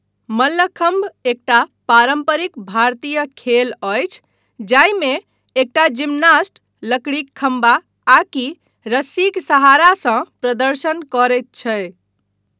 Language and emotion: Maithili, neutral